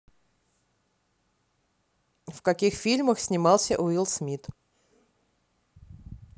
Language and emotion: Russian, neutral